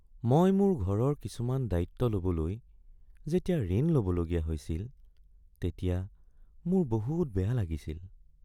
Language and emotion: Assamese, sad